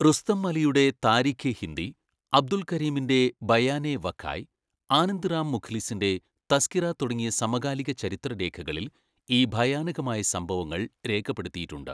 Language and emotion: Malayalam, neutral